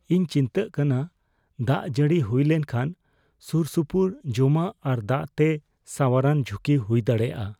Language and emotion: Santali, fearful